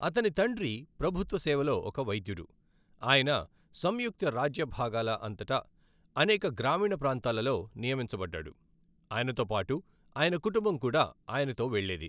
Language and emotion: Telugu, neutral